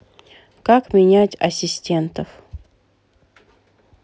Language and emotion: Russian, neutral